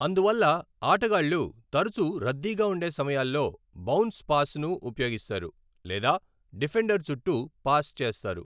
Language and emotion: Telugu, neutral